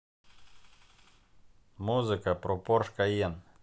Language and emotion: Russian, neutral